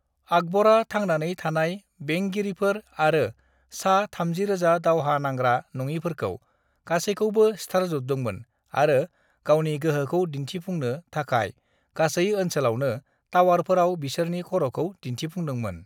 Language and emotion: Bodo, neutral